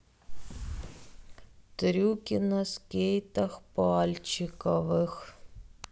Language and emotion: Russian, sad